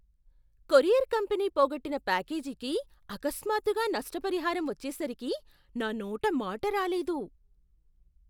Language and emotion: Telugu, surprised